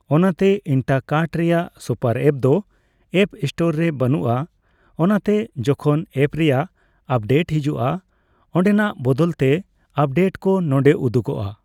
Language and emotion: Santali, neutral